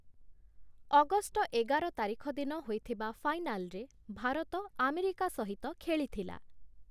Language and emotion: Odia, neutral